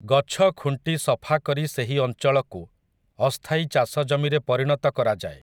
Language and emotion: Odia, neutral